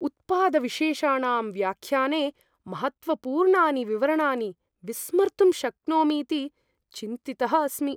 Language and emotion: Sanskrit, fearful